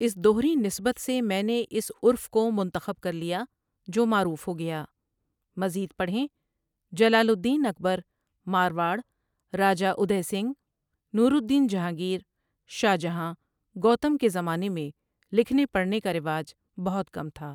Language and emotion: Urdu, neutral